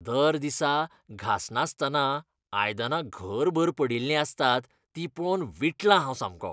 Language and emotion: Goan Konkani, disgusted